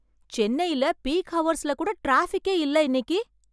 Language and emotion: Tamil, surprised